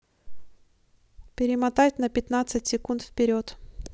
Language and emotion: Russian, neutral